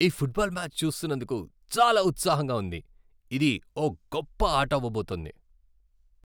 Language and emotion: Telugu, happy